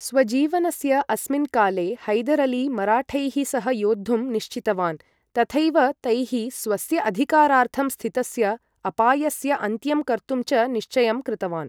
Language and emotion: Sanskrit, neutral